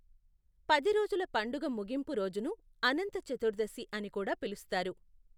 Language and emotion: Telugu, neutral